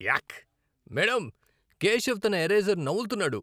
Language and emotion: Telugu, disgusted